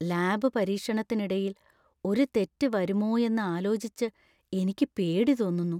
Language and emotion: Malayalam, fearful